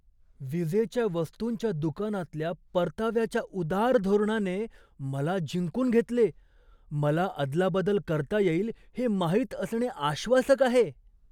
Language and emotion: Marathi, surprised